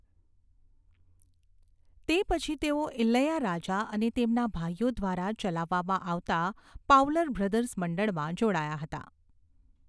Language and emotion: Gujarati, neutral